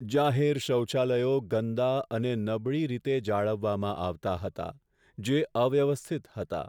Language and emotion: Gujarati, sad